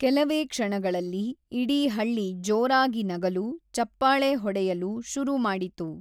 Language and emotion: Kannada, neutral